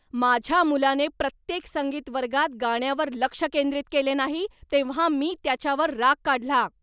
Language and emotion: Marathi, angry